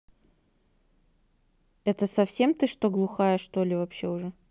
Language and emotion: Russian, neutral